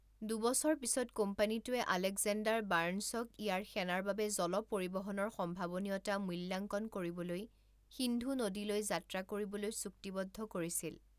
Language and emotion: Assamese, neutral